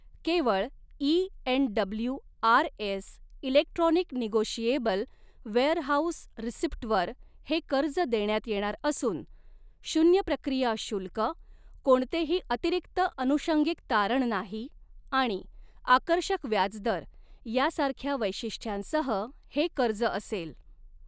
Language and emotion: Marathi, neutral